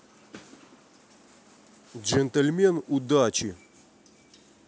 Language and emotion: Russian, neutral